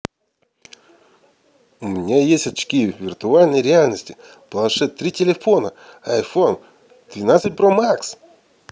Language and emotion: Russian, positive